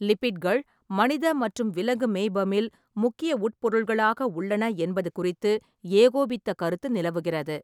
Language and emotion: Tamil, neutral